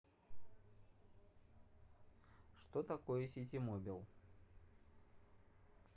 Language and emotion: Russian, neutral